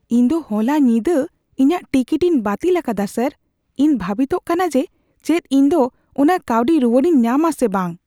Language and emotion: Santali, fearful